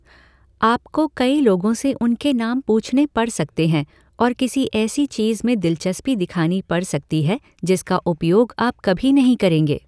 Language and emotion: Hindi, neutral